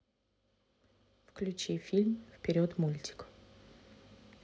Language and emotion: Russian, neutral